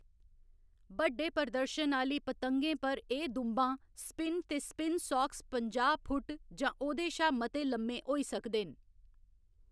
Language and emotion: Dogri, neutral